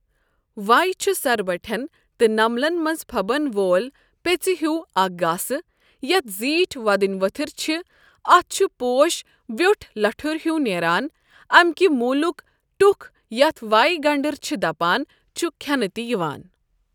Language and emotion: Kashmiri, neutral